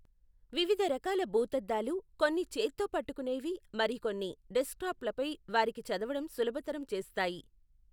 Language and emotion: Telugu, neutral